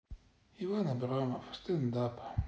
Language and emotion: Russian, sad